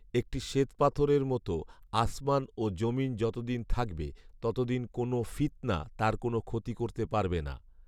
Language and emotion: Bengali, neutral